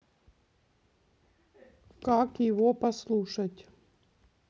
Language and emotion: Russian, neutral